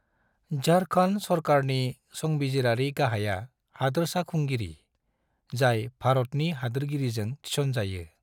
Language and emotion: Bodo, neutral